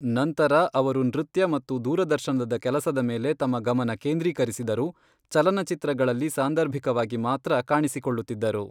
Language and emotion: Kannada, neutral